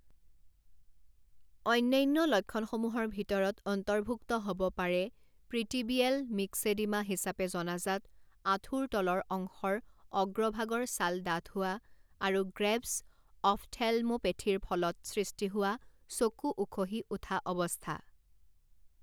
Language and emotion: Assamese, neutral